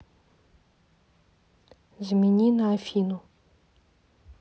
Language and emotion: Russian, neutral